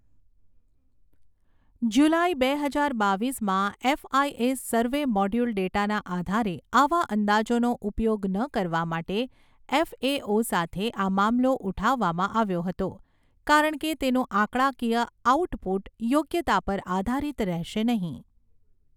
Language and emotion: Gujarati, neutral